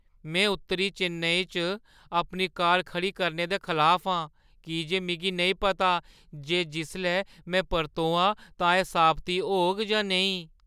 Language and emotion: Dogri, fearful